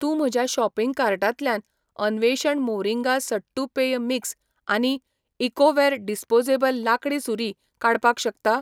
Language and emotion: Goan Konkani, neutral